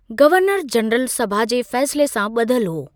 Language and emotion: Sindhi, neutral